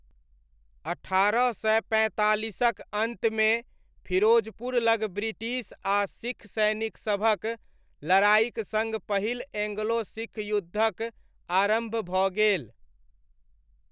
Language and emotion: Maithili, neutral